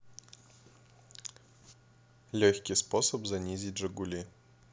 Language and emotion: Russian, neutral